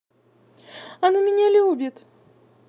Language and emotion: Russian, positive